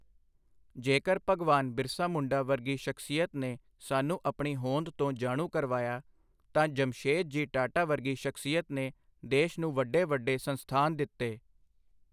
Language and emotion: Punjabi, neutral